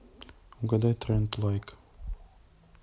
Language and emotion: Russian, neutral